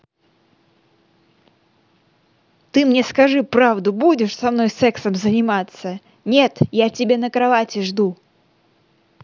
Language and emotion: Russian, angry